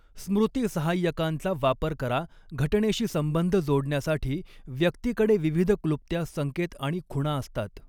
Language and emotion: Marathi, neutral